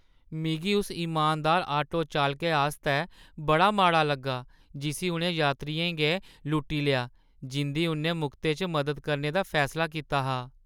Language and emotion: Dogri, sad